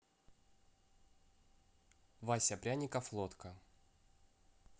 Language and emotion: Russian, neutral